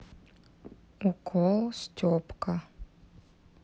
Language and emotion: Russian, neutral